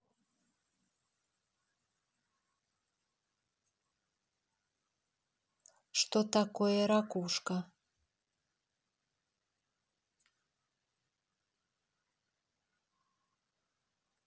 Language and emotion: Russian, neutral